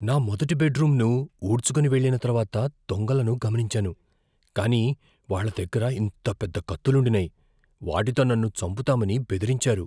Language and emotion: Telugu, fearful